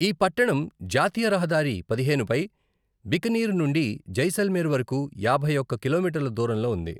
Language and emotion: Telugu, neutral